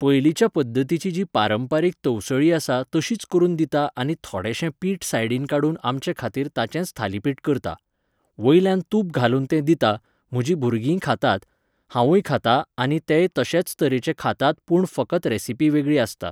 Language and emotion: Goan Konkani, neutral